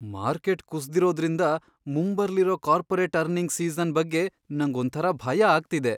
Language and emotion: Kannada, fearful